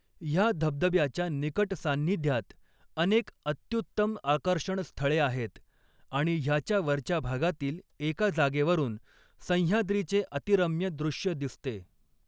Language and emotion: Marathi, neutral